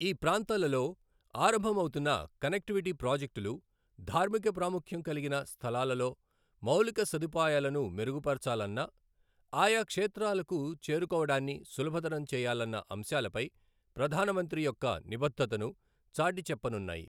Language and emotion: Telugu, neutral